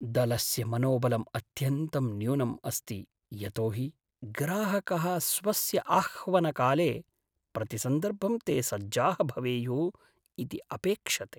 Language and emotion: Sanskrit, sad